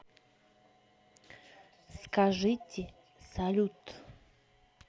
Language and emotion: Russian, neutral